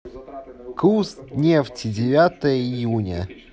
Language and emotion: Russian, neutral